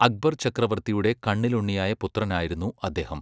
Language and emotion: Malayalam, neutral